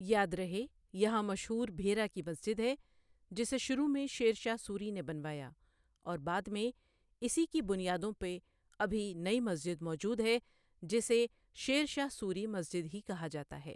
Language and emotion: Urdu, neutral